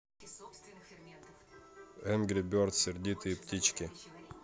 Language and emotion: Russian, neutral